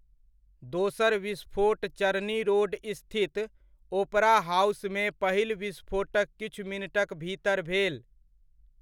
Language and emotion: Maithili, neutral